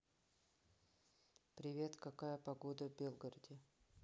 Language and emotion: Russian, neutral